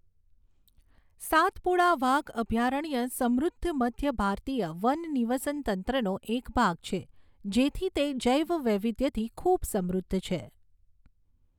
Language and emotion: Gujarati, neutral